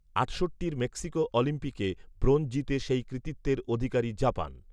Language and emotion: Bengali, neutral